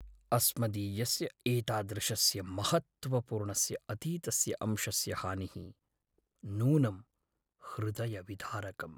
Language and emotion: Sanskrit, sad